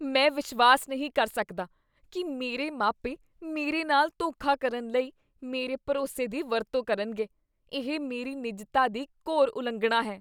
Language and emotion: Punjabi, disgusted